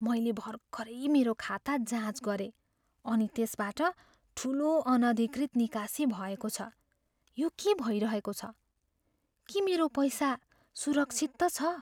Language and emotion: Nepali, fearful